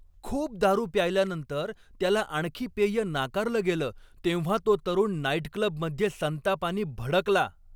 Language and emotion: Marathi, angry